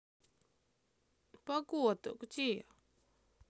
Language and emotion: Russian, sad